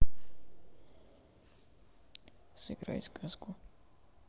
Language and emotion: Russian, neutral